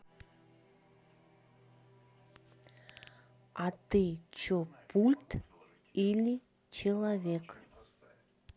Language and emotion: Russian, neutral